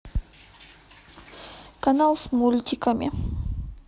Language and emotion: Russian, neutral